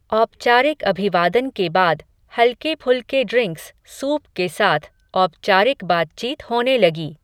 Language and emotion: Hindi, neutral